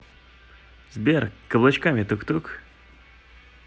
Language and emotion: Russian, positive